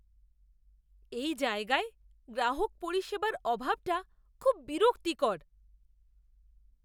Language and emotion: Bengali, disgusted